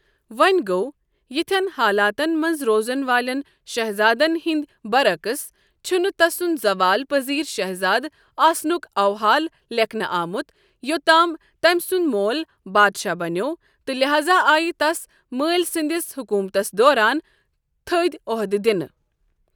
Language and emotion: Kashmiri, neutral